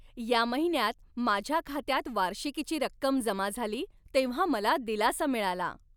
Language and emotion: Marathi, happy